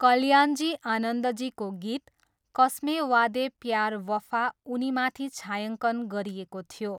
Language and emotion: Nepali, neutral